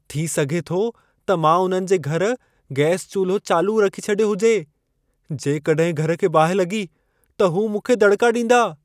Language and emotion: Sindhi, fearful